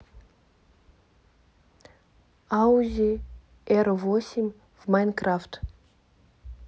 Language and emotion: Russian, neutral